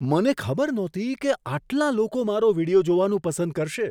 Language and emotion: Gujarati, surprised